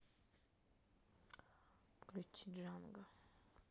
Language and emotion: Russian, neutral